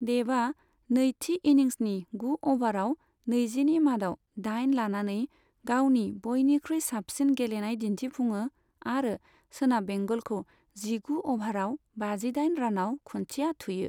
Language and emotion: Bodo, neutral